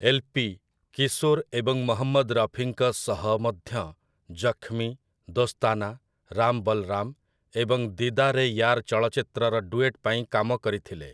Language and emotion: Odia, neutral